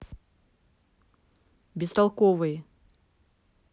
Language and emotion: Russian, angry